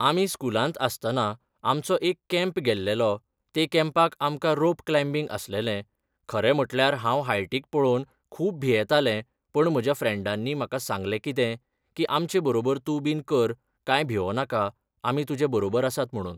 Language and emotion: Goan Konkani, neutral